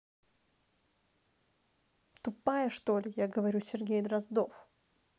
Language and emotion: Russian, angry